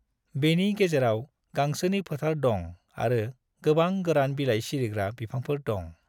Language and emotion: Bodo, neutral